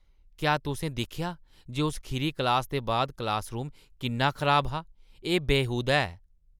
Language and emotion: Dogri, disgusted